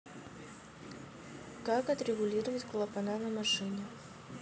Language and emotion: Russian, neutral